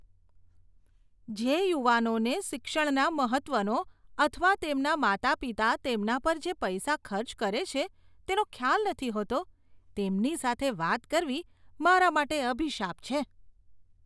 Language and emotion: Gujarati, disgusted